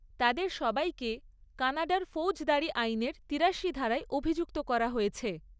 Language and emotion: Bengali, neutral